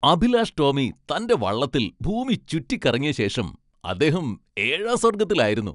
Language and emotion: Malayalam, happy